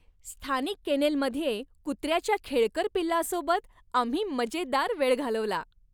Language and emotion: Marathi, happy